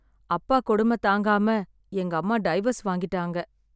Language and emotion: Tamil, sad